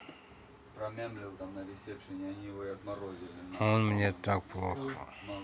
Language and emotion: Russian, sad